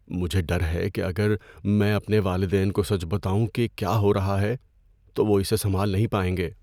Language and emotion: Urdu, fearful